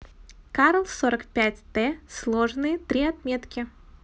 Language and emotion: Russian, positive